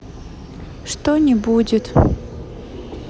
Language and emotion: Russian, sad